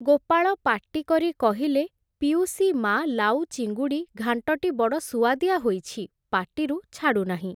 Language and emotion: Odia, neutral